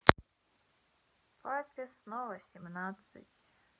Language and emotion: Russian, sad